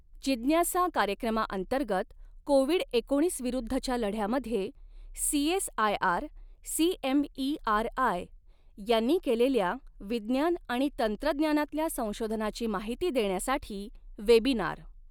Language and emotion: Marathi, neutral